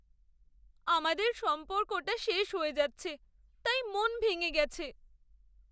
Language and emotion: Bengali, sad